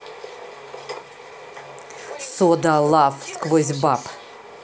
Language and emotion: Russian, neutral